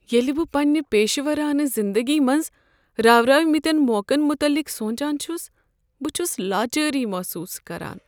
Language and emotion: Kashmiri, sad